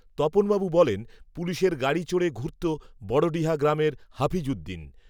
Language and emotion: Bengali, neutral